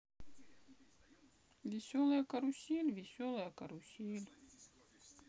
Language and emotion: Russian, sad